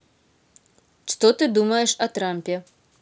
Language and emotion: Russian, neutral